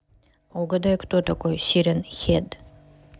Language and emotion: Russian, neutral